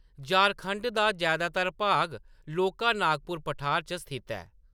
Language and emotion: Dogri, neutral